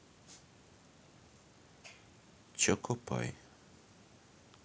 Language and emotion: Russian, neutral